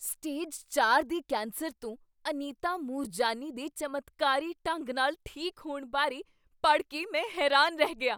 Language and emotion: Punjabi, surprised